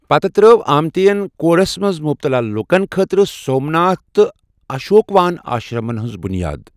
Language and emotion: Kashmiri, neutral